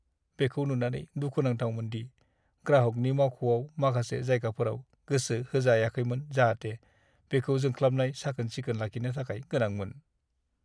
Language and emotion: Bodo, sad